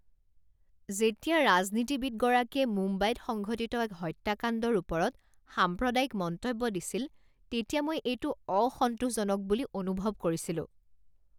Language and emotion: Assamese, disgusted